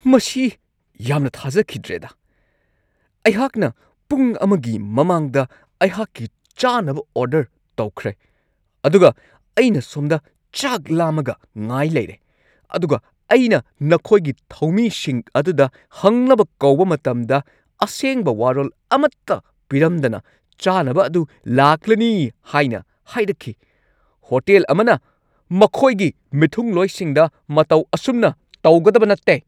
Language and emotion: Manipuri, angry